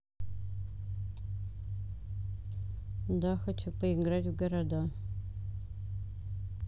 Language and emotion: Russian, neutral